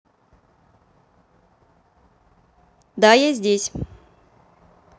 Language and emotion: Russian, neutral